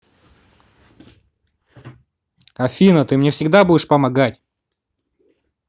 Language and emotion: Russian, positive